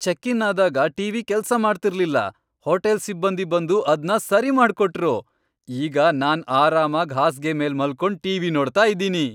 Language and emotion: Kannada, happy